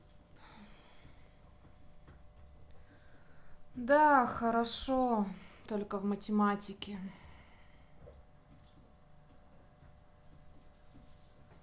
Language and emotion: Russian, sad